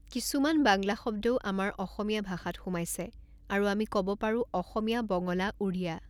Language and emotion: Assamese, neutral